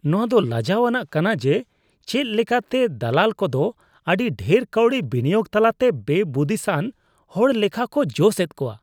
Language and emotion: Santali, disgusted